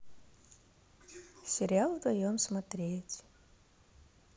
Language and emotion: Russian, neutral